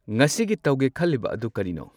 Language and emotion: Manipuri, neutral